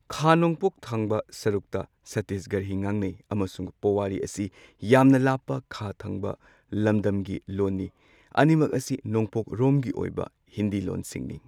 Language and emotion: Manipuri, neutral